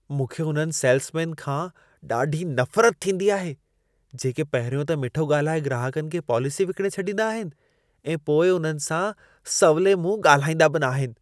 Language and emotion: Sindhi, disgusted